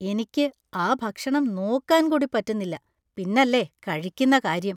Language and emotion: Malayalam, disgusted